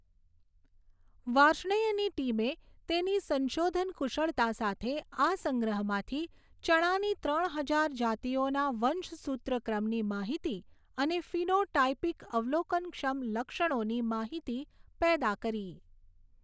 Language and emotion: Gujarati, neutral